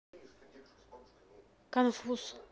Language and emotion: Russian, neutral